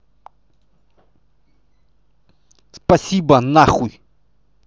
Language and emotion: Russian, angry